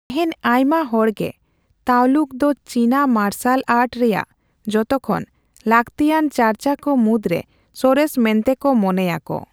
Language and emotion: Santali, neutral